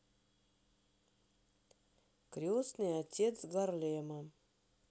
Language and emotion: Russian, neutral